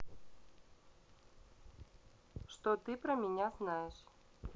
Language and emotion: Russian, neutral